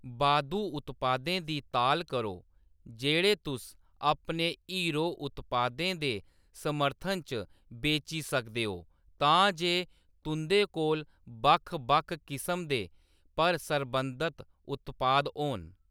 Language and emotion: Dogri, neutral